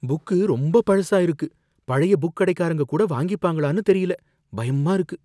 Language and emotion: Tamil, fearful